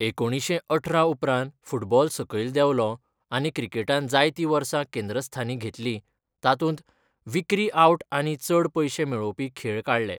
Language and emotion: Goan Konkani, neutral